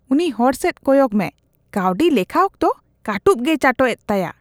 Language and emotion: Santali, disgusted